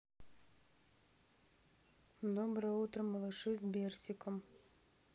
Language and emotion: Russian, neutral